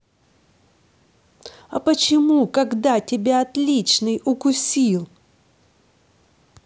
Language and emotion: Russian, angry